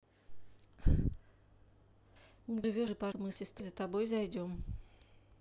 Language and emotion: Russian, neutral